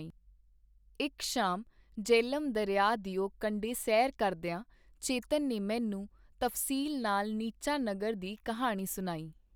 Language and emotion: Punjabi, neutral